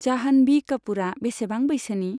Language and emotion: Bodo, neutral